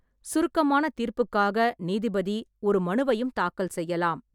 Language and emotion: Tamil, neutral